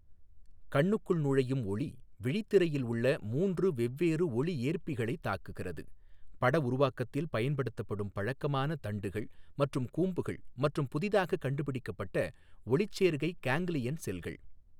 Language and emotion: Tamil, neutral